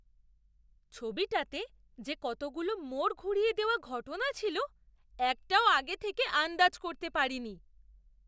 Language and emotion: Bengali, surprised